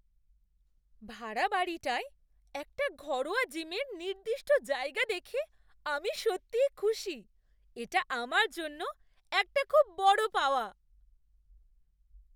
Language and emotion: Bengali, surprised